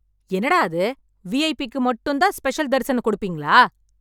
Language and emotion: Tamil, angry